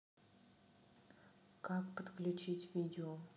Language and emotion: Russian, neutral